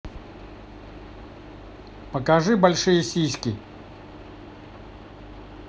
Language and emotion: Russian, neutral